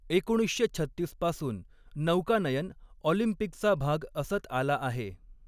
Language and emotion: Marathi, neutral